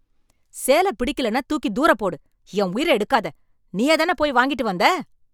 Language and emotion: Tamil, angry